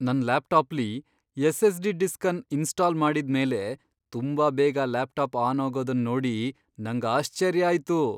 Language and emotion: Kannada, surprised